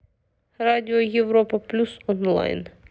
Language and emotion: Russian, neutral